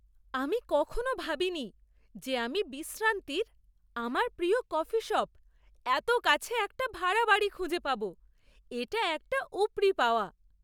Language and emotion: Bengali, surprised